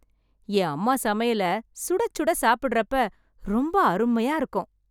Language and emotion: Tamil, happy